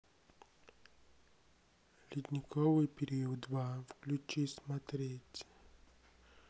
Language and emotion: Russian, neutral